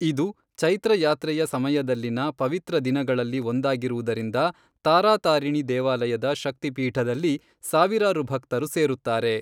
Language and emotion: Kannada, neutral